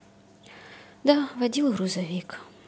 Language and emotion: Russian, sad